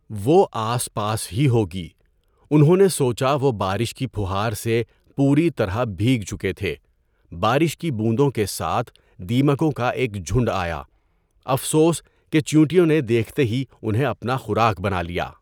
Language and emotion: Urdu, neutral